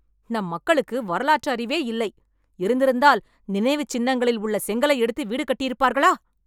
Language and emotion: Tamil, angry